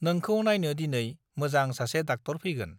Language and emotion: Bodo, neutral